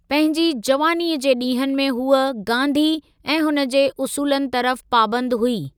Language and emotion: Sindhi, neutral